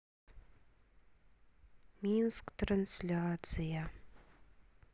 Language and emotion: Russian, sad